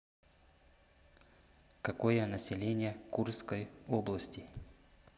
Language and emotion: Russian, neutral